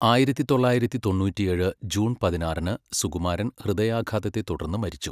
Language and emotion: Malayalam, neutral